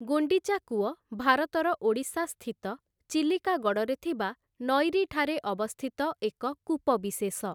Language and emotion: Odia, neutral